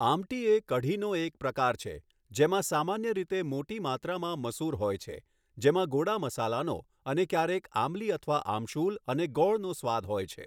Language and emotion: Gujarati, neutral